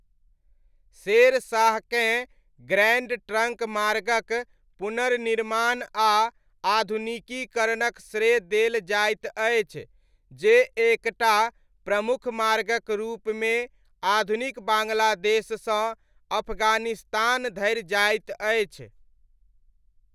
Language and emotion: Maithili, neutral